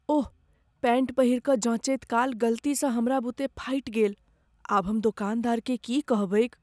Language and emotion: Maithili, fearful